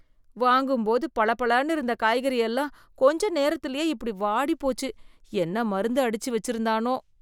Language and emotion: Tamil, disgusted